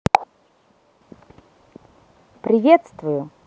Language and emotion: Russian, positive